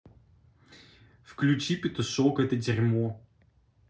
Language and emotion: Russian, neutral